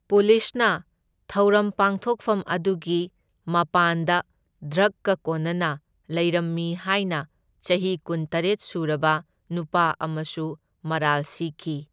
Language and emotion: Manipuri, neutral